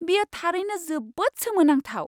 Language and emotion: Bodo, surprised